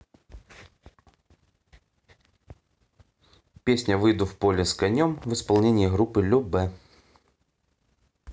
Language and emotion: Russian, neutral